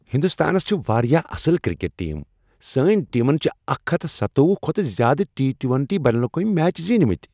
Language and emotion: Kashmiri, happy